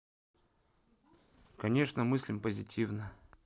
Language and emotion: Russian, neutral